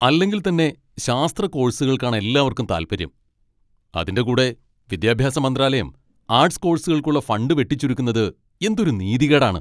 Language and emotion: Malayalam, angry